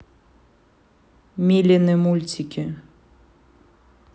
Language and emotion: Russian, neutral